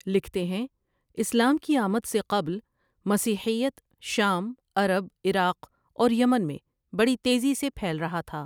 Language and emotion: Urdu, neutral